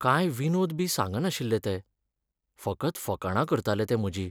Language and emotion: Goan Konkani, sad